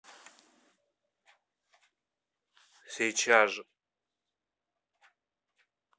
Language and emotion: Russian, neutral